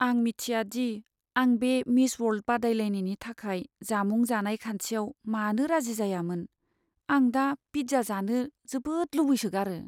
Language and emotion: Bodo, sad